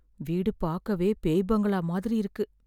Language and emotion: Tamil, fearful